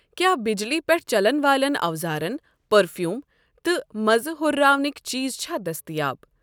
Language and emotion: Kashmiri, neutral